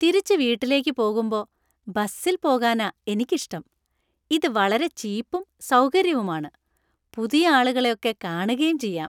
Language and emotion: Malayalam, happy